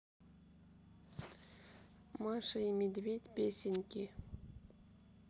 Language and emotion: Russian, neutral